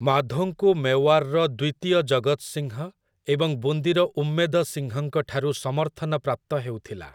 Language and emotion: Odia, neutral